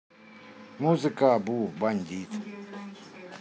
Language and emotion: Russian, neutral